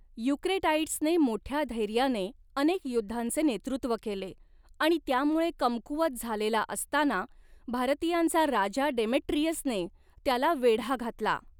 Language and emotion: Marathi, neutral